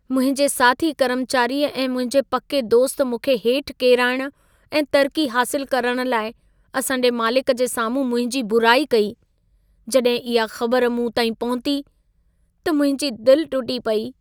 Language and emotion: Sindhi, sad